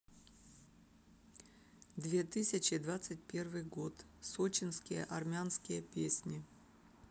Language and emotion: Russian, neutral